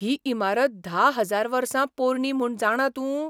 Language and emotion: Goan Konkani, surprised